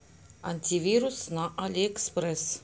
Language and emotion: Russian, neutral